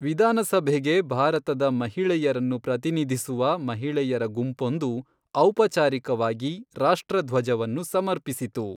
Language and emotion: Kannada, neutral